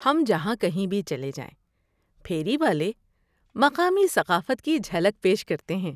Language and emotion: Urdu, happy